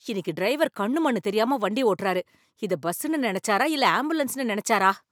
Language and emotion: Tamil, angry